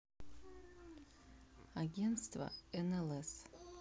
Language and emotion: Russian, neutral